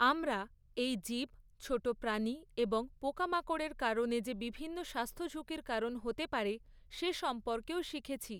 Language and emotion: Bengali, neutral